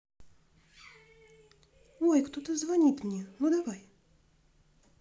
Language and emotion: Russian, positive